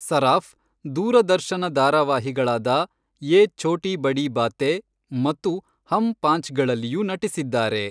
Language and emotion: Kannada, neutral